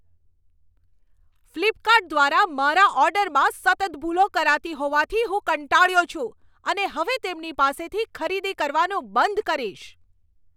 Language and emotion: Gujarati, angry